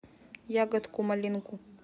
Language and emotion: Russian, neutral